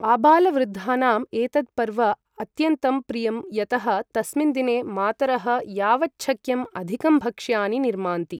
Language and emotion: Sanskrit, neutral